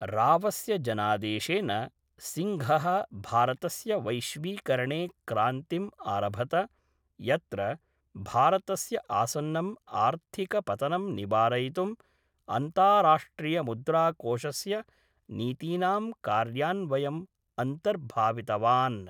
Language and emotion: Sanskrit, neutral